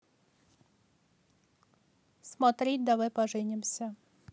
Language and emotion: Russian, neutral